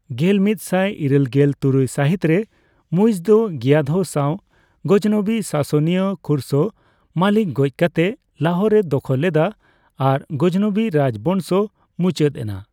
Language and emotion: Santali, neutral